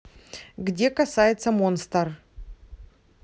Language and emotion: Russian, neutral